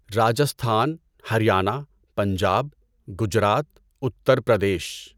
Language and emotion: Urdu, neutral